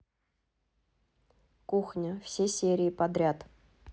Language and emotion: Russian, neutral